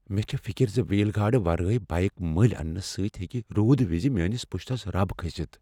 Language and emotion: Kashmiri, fearful